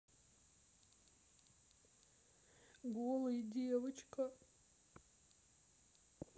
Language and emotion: Russian, sad